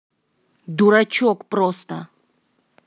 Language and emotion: Russian, angry